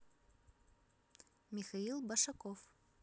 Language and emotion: Russian, neutral